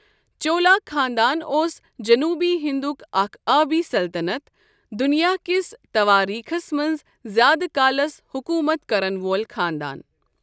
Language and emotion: Kashmiri, neutral